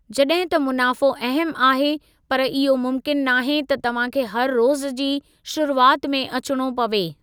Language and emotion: Sindhi, neutral